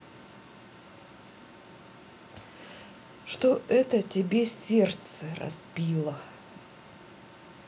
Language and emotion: Russian, neutral